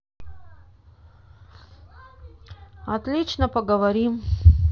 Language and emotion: Russian, sad